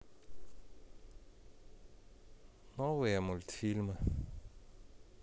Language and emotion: Russian, sad